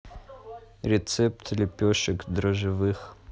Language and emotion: Russian, neutral